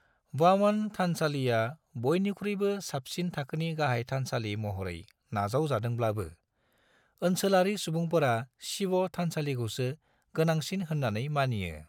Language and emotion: Bodo, neutral